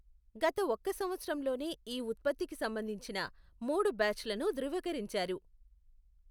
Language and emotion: Telugu, neutral